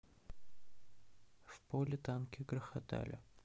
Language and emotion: Russian, sad